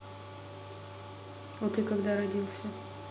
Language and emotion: Russian, neutral